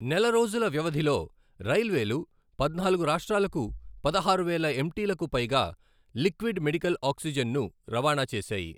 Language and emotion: Telugu, neutral